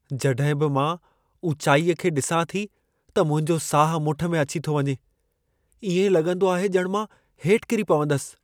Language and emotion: Sindhi, fearful